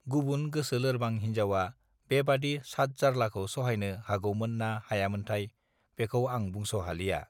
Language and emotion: Bodo, neutral